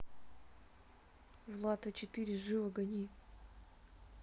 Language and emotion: Russian, neutral